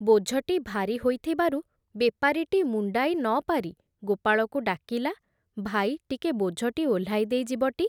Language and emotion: Odia, neutral